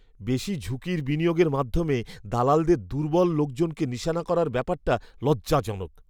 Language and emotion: Bengali, disgusted